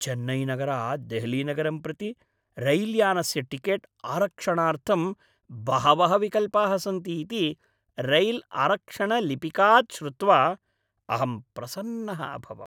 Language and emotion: Sanskrit, happy